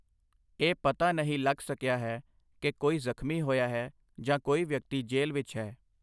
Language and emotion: Punjabi, neutral